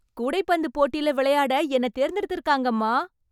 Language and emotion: Tamil, happy